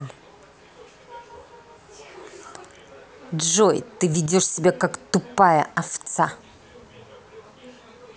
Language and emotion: Russian, angry